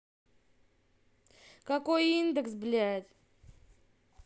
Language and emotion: Russian, angry